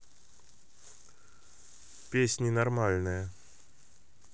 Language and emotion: Russian, neutral